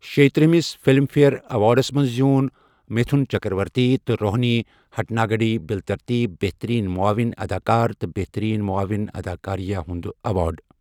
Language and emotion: Kashmiri, neutral